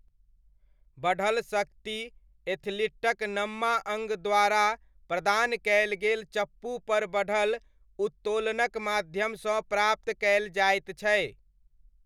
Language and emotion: Maithili, neutral